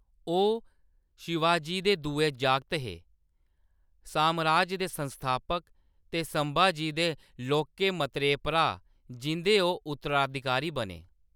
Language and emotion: Dogri, neutral